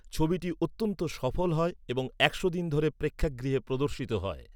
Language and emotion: Bengali, neutral